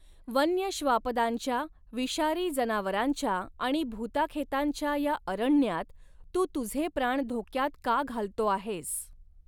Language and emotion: Marathi, neutral